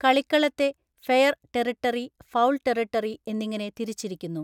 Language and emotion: Malayalam, neutral